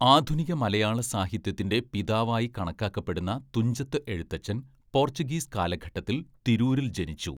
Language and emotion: Malayalam, neutral